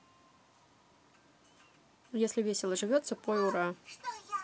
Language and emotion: Russian, neutral